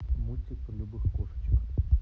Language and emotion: Russian, neutral